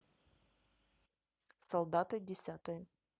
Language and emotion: Russian, neutral